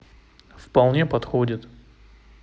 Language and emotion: Russian, neutral